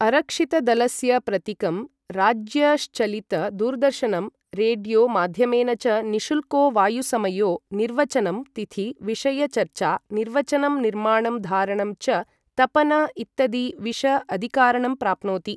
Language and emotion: Sanskrit, neutral